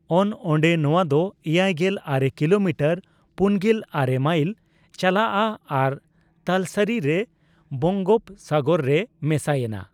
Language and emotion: Santali, neutral